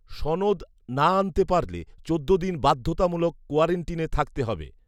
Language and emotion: Bengali, neutral